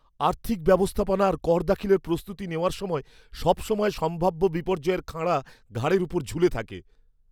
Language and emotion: Bengali, fearful